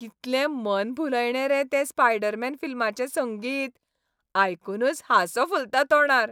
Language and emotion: Goan Konkani, happy